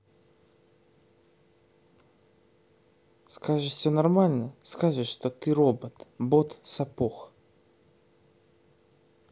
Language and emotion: Russian, sad